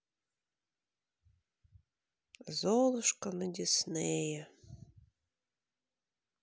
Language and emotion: Russian, sad